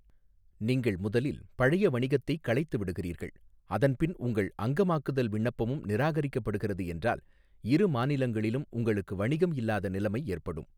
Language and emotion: Tamil, neutral